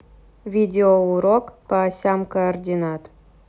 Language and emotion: Russian, neutral